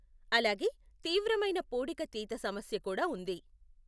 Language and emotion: Telugu, neutral